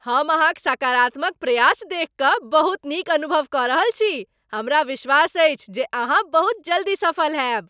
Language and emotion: Maithili, happy